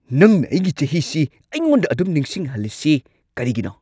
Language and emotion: Manipuri, angry